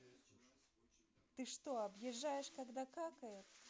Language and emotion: Russian, neutral